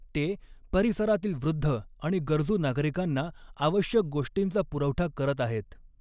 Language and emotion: Marathi, neutral